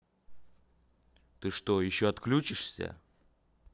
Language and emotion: Russian, angry